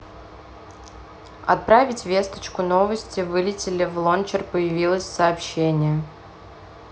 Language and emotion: Russian, neutral